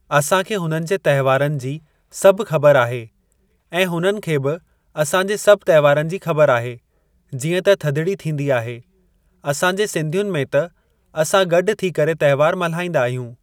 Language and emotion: Sindhi, neutral